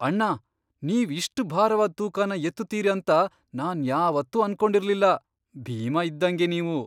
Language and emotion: Kannada, surprised